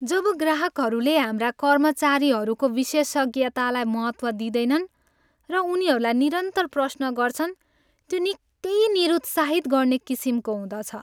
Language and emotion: Nepali, sad